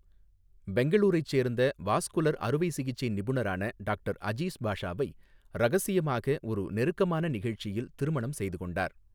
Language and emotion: Tamil, neutral